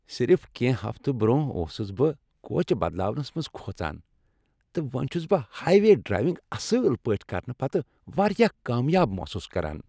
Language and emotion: Kashmiri, happy